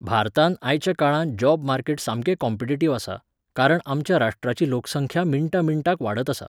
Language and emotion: Goan Konkani, neutral